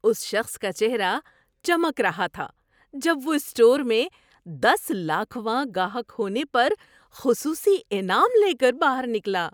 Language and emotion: Urdu, happy